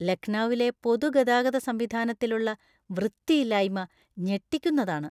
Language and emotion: Malayalam, disgusted